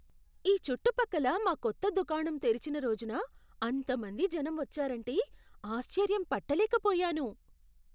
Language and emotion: Telugu, surprised